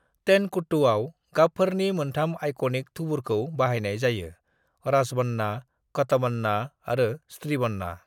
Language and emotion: Bodo, neutral